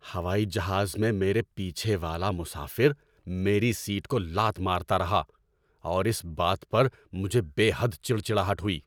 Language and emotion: Urdu, angry